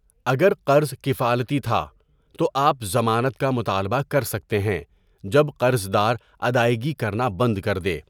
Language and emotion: Urdu, neutral